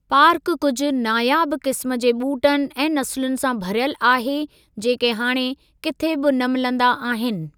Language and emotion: Sindhi, neutral